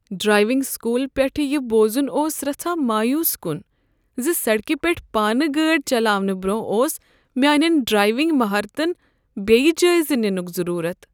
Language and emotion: Kashmiri, sad